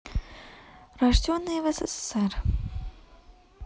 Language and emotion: Russian, neutral